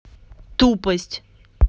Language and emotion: Russian, angry